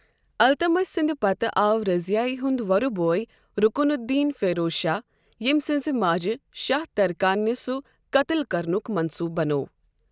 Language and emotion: Kashmiri, neutral